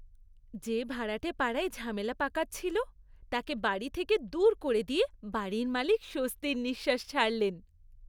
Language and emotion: Bengali, happy